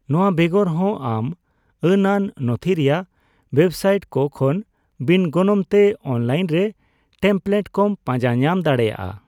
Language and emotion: Santali, neutral